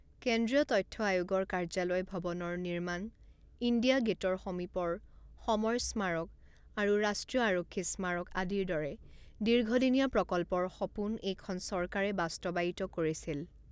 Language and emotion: Assamese, neutral